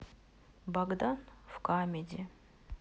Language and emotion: Russian, sad